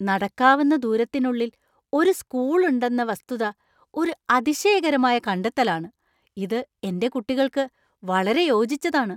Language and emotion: Malayalam, surprised